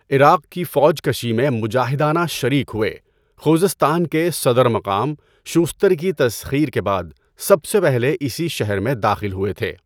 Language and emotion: Urdu, neutral